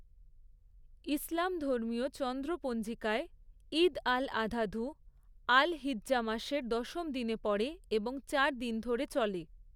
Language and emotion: Bengali, neutral